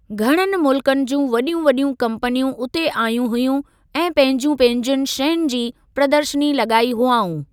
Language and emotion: Sindhi, neutral